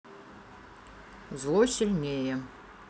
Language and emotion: Russian, neutral